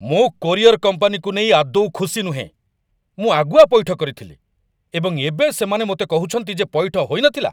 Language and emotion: Odia, angry